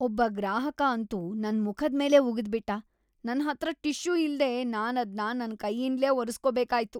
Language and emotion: Kannada, disgusted